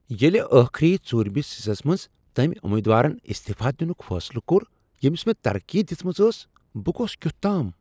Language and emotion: Kashmiri, surprised